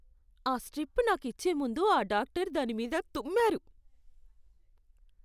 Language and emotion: Telugu, disgusted